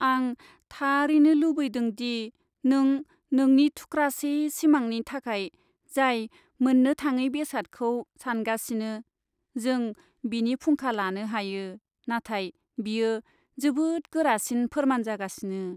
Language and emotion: Bodo, sad